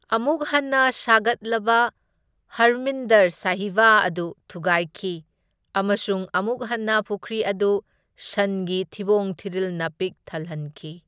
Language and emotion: Manipuri, neutral